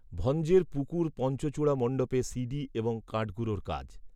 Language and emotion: Bengali, neutral